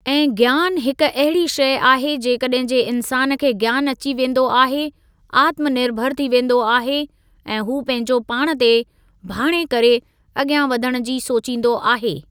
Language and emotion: Sindhi, neutral